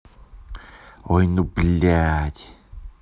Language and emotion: Russian, angry